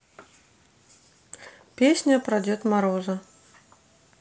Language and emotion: Russian, neutral